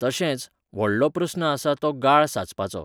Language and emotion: Goan Konkani, neutral